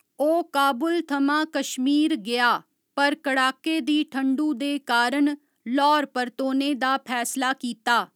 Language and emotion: Dogri, neutral